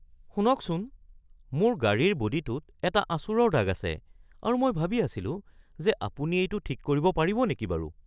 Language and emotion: Assamese, surprised